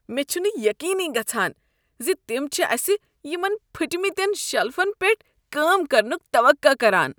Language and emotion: Kashmiri, disgusted